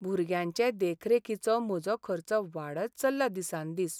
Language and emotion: Goan Konkani, sad